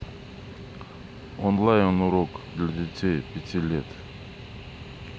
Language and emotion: Russian, neutral